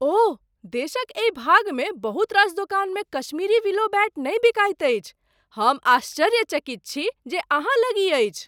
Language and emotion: Maithili, surprised